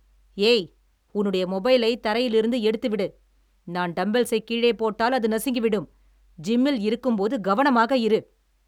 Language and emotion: Tamil, angry